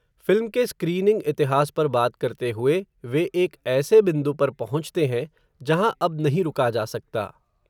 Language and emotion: Hindi, neutral